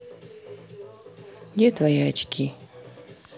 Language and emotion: Russian, neutral